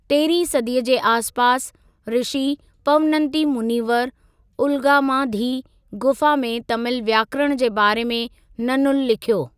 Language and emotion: Sindhi, neutral